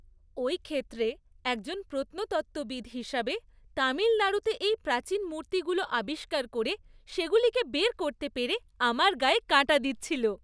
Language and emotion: Bengali, happy